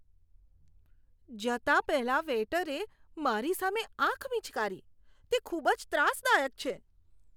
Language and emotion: Gujarati, disgusted